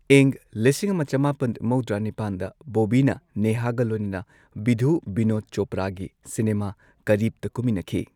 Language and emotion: Manipuri, neutral